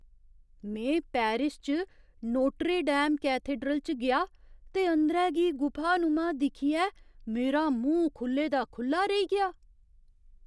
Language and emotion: Dogri, surprised